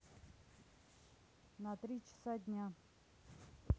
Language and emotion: Russian, neutral